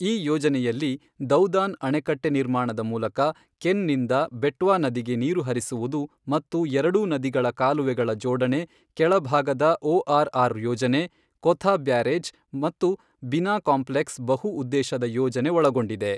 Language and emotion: Kannada, neutral